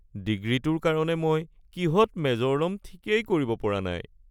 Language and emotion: Assamese, sad